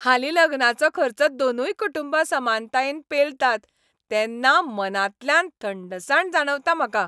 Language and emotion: Goan Konkani, happy